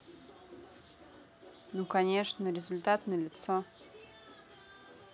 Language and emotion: Russian, neutral